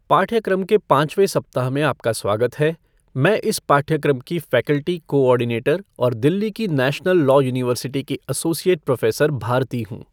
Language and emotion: Hindi, neutral